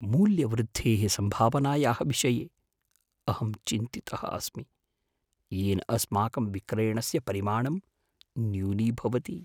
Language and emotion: Sanskrit, fearful